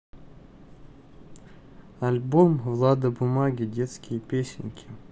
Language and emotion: Russian, neutral